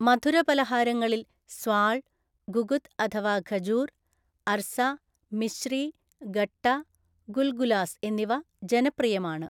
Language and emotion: Malayalam, neutral